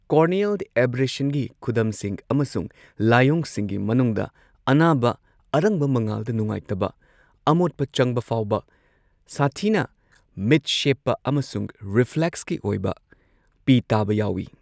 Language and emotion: Manipuri, neutral